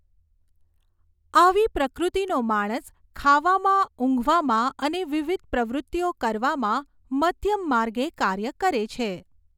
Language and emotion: Gujarati, neutral